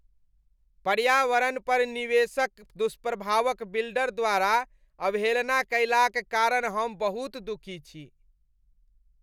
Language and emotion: Maithili, disgusted